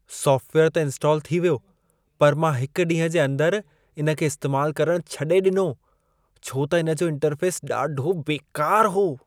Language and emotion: Sindhi, disgusted